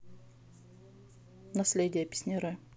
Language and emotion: Russian, neutral